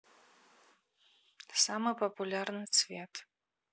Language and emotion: Russian, neutral